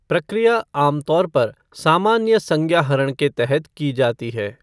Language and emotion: Hindi, neutral